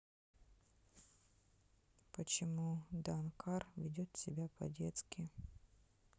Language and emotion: Russian, sad